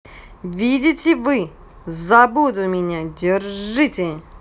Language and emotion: Russian, neutral